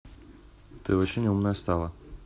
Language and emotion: Russian, neutral